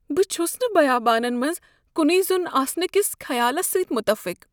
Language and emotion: Kashmiri, fearful